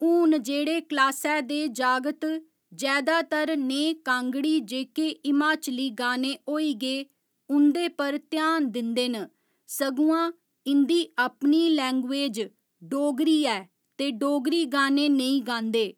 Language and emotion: Dogri, neutral